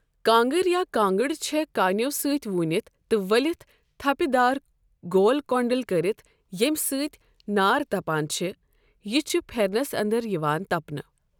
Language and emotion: Kashmiri, neutral